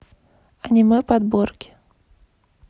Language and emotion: Russian, neutral